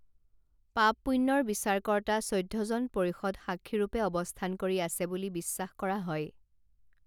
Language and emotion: Assamese, neutral